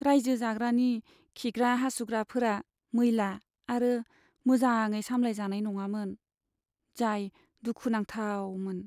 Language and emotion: Bodo, sad